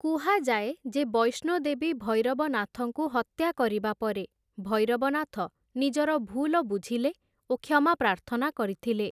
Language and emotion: Odia, neutral